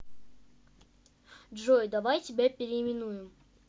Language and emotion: Russian, neutral